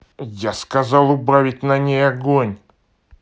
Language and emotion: Russian, angry